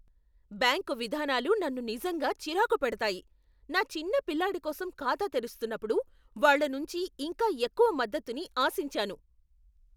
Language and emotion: Telugu, angry